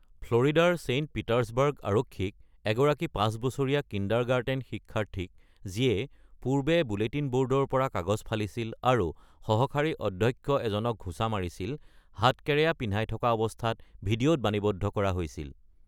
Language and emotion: Assamese, neutral